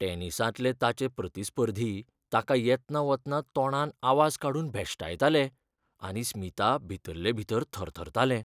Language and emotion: Goan Konkani, fearful